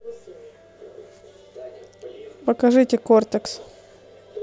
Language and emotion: Russian, neutral